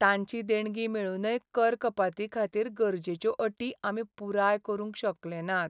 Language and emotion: Goan Konkani, sad